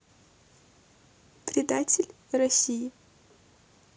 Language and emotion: Russian, neutral